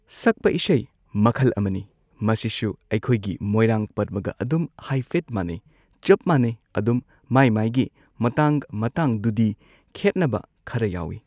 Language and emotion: Manipuri, neutral